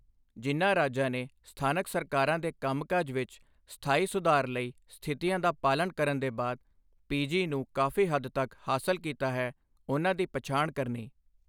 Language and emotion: Punjabi, neutral